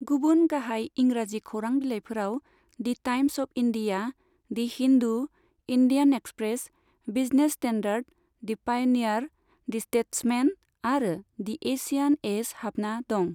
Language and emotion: Bodo, neutral